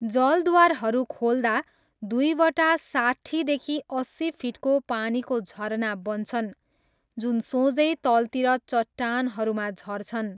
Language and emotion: Nepali, neutral